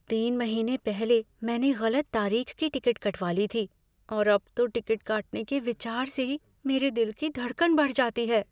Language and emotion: Hindi, fearful